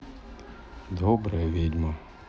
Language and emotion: Russian, neutral